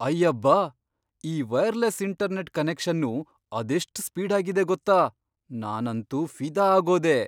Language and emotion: Kannada, surprised